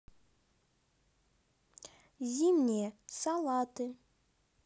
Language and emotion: Russian, neutral